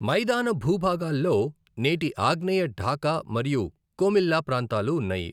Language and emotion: Telugu, neutral